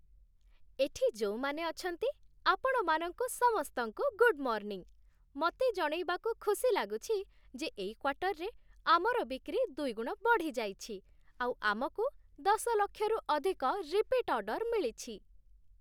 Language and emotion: Odia, happy